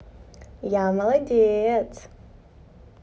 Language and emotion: Russian, positive